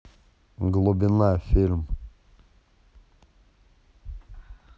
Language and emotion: Russian, neutral